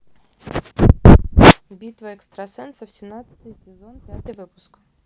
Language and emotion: Russian, neutral